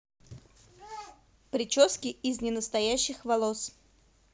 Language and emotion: Russian, neutral